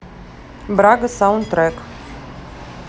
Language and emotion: Russian, neutral